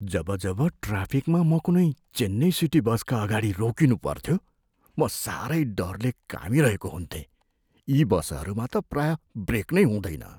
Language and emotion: Nepali, fearful